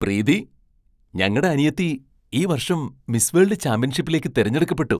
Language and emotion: Malayalam, surprised